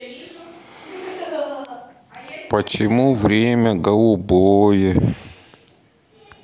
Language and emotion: Russian, sad